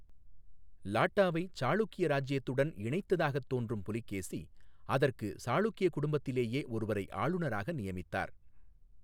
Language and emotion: Tamil, neutral